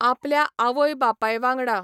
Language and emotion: Goan Konkani, neutral